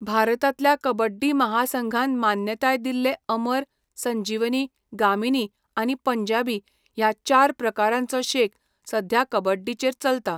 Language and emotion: Goan Konkani, neutral